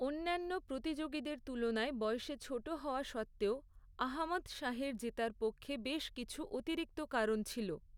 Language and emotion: Bengali, neutral